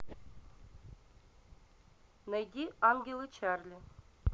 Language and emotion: Russian, neutral